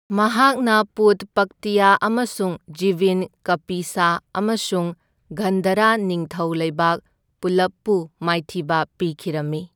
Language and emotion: Manipuri, neutral